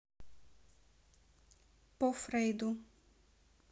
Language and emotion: Russian, neutral